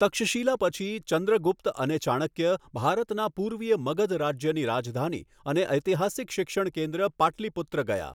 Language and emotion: Gujarati, neutral